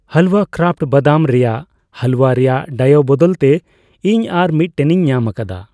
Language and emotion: Santali, neutral